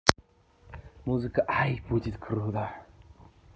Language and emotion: Russian, positive